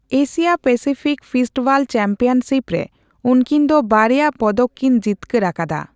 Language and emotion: Santali, neutral